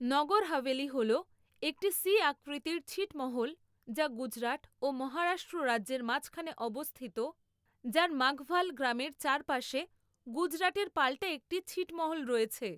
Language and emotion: Bengali, neutral